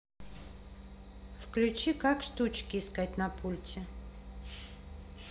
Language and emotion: Russian, neutral